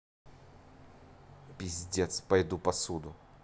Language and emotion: Russian, angry